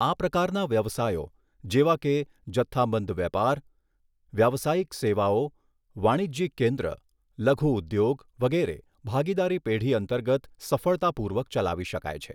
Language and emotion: Gujarati, neutral